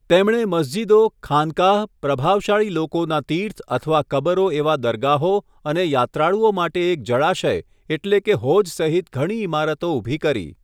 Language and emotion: Gujarati, neutral